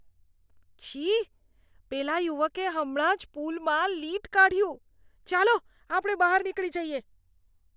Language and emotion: Gujarati, disgusted